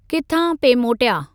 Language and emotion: Sindhi, neutral